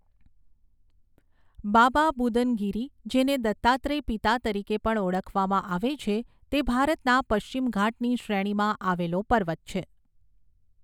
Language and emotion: Gujarati, neutral